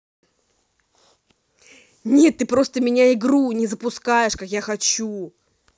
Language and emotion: Russian, angry